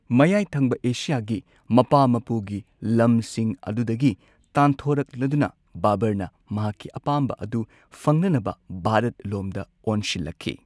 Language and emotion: Manipuri, neutral